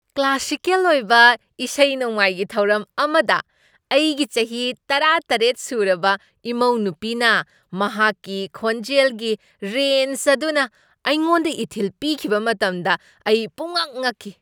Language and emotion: Manipuri, surprised